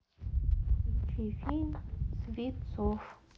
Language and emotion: Russian, neutral